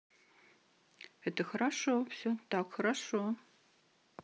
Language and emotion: Russian, neutral